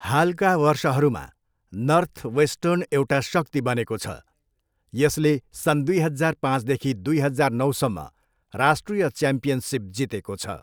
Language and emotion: Nepali, neutral